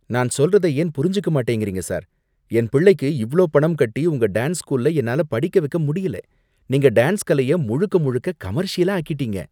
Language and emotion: Tamil, disgusted